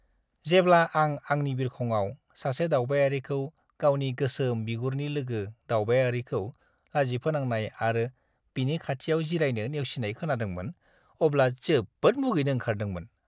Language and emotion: Bodo, disgusted